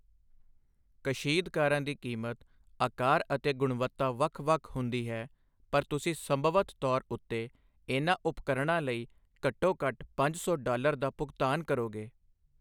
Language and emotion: Punjabi, neutral